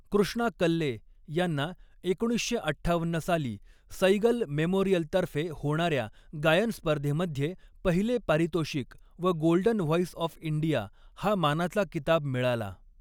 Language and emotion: Marathi, neutral